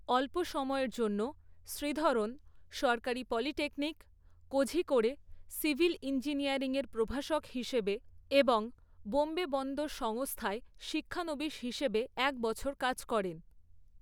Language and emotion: Bengali, neutral